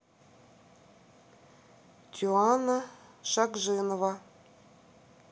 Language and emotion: Russian, neutral